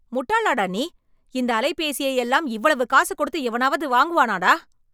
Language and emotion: Tamil, angry